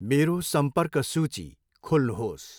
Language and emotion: Nepali, neutral